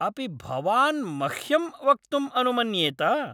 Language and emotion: Sanskrit, angry